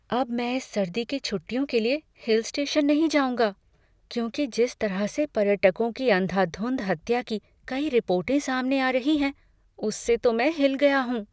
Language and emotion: Hindi, fearful